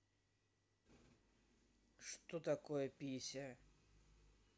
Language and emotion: Russian, neutral